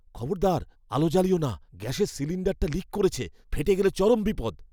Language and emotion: Bengali, fearful